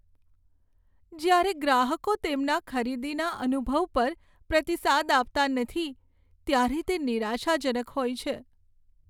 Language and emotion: Gujarati, sad